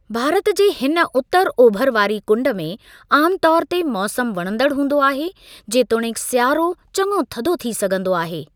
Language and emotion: Sindhi, neutral